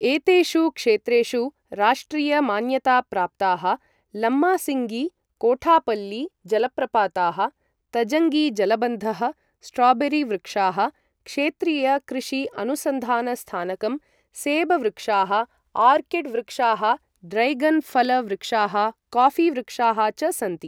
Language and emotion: Sanskrit, neutral